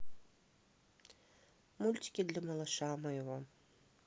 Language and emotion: Russian, neutral